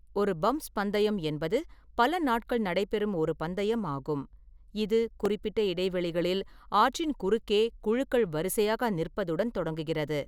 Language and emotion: Tamil, neutral